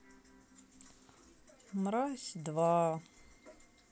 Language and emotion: Russian, sad